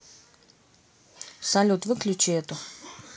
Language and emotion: Russian, neutral